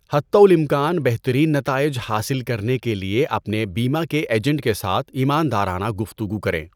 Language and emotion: Urdu, neutral